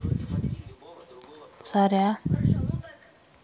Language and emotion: Russian, neutral